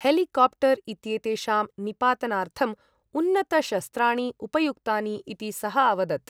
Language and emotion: Sanskrit, neutral